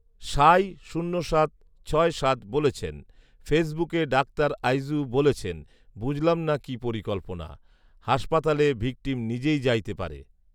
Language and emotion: Bengali, neutral